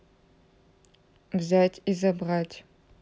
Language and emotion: Russian, neutral